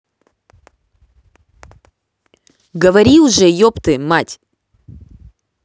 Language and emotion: Russian, angry